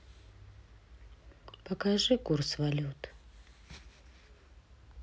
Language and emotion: Russian, sad